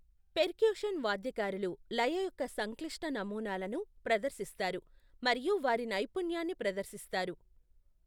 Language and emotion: Telugu, neutral